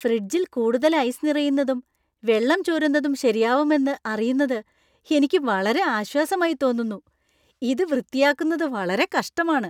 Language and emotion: Malayalam, happy